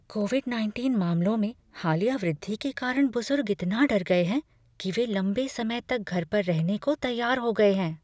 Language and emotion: Hindi, fearful